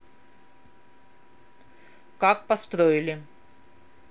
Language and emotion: Russian, neutral